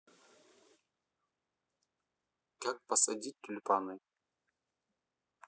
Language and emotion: Russian, neutral